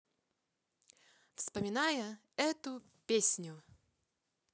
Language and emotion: Russian, positive